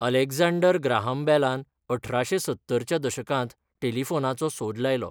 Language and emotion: Goan Konkani, neutral